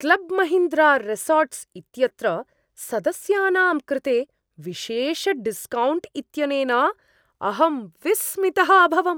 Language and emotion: Sanskrit, surprised